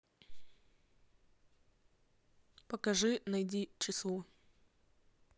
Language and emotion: Russian, neutral